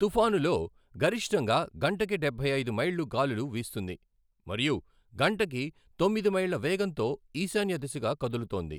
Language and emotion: Telugu, neutral